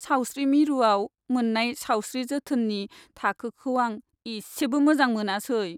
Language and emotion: Bodo, sad